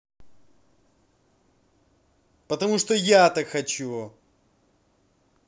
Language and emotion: Russian, angry